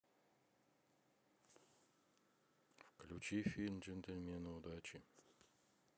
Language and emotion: Russian, neutral